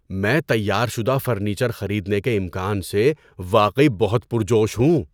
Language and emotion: Urdu, surprised